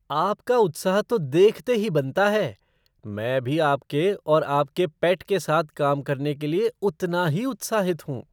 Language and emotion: Hindi, surprised